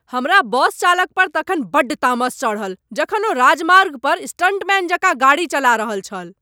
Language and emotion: Maithili, angry